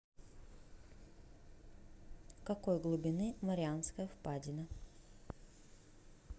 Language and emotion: Russian, neutral